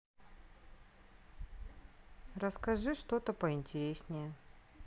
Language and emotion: Russian, neutral